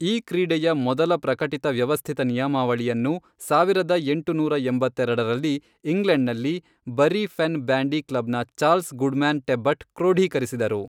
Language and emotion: Kannada, neutral